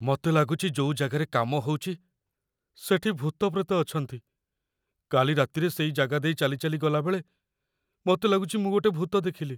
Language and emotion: Odia, fearful